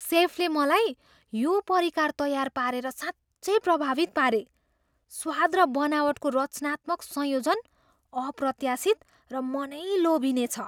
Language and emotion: Nepali, surprised